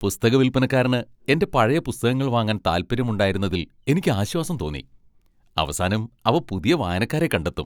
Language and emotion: Malayalam, happy